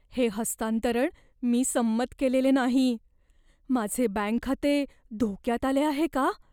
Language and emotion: Marathi, fearful